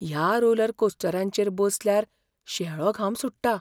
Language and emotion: Goan Konkani, fearful